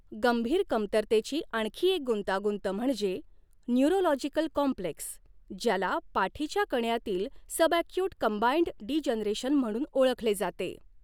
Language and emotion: Marathi, neutral